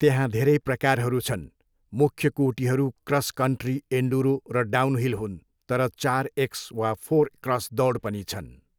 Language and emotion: Nepali, neutral